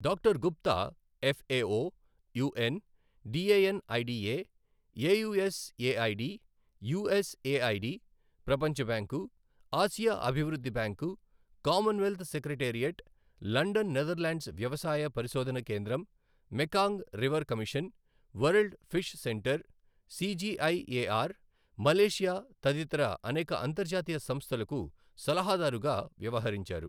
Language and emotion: Telugu, neutral